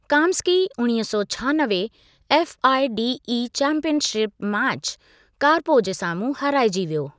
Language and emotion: Sindhi, neutral